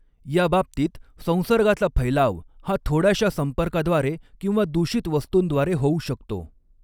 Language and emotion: Marathi, neutral